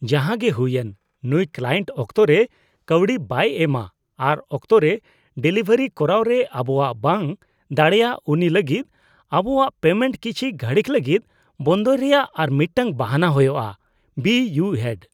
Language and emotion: Santali, disgusted